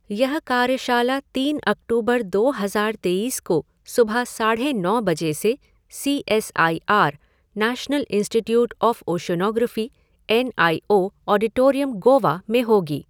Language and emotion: Hindi, neutral